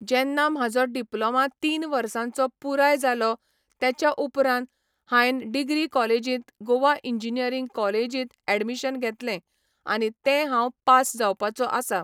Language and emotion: Goan Konkani, neutral